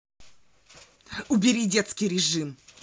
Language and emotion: Russian, angry